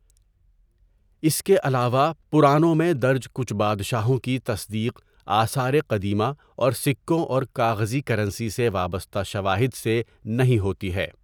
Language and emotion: Urdu, neutral